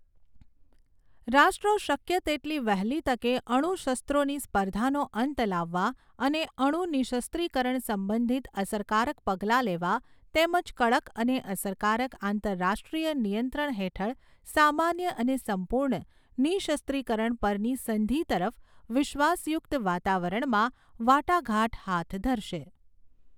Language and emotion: Gujarati, neutral